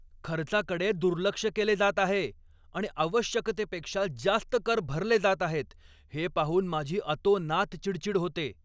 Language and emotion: Marathi, angry